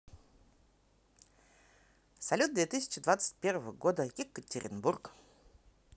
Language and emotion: Russian, positive